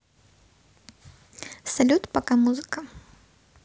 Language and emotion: Russian, neutral